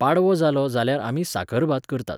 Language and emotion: Goan Konkani, neutral